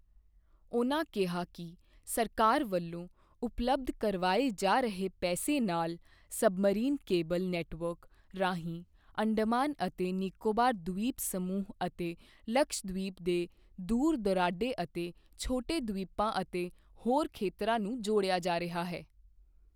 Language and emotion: Punjabi, neutral